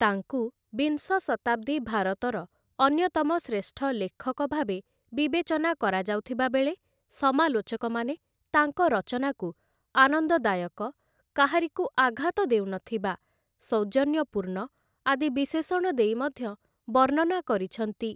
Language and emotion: Odia, neutral